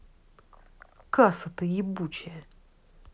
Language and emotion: Russian, angry